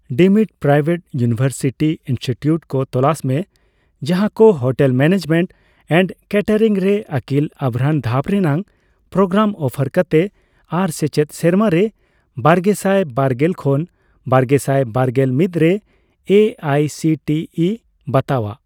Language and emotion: Santali, neutral